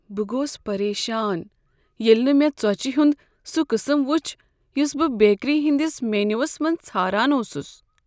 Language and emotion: Kashmiri, sad